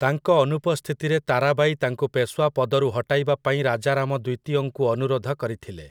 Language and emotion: Odia, neutral